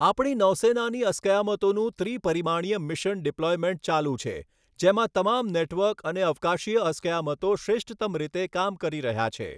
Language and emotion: Gujarati, neutral